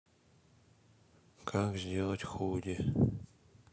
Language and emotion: Russian, sad